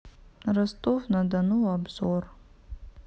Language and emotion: Russian, sad